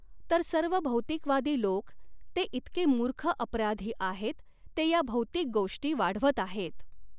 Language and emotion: Marathi, neutral